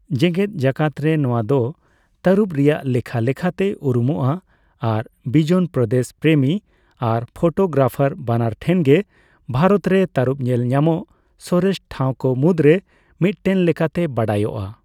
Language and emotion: Santali, neutral